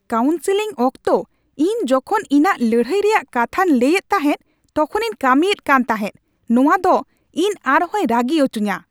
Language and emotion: Santali, angry